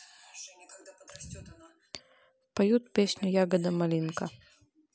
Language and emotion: Russian, neutral